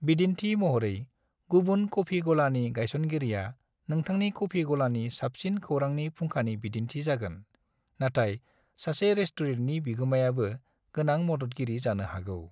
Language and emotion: Bodo, neutral